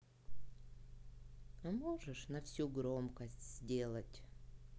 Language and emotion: Russian, sad